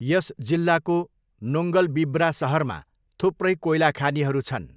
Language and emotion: Nepali, neutral